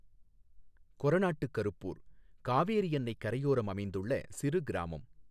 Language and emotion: Tamil, neutral